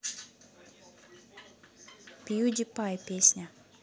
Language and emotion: Russian, neutral